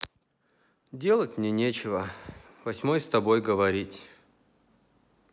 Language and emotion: Russian, sad